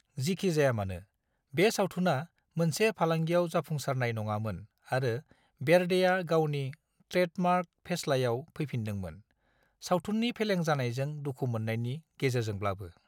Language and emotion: Bodo, neutral